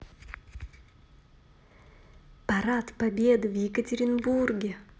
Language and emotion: Russian, positive